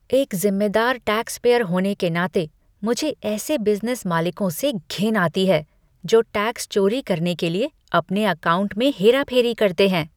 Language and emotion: Hindi, disgusted